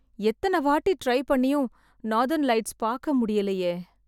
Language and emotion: Tamil, sad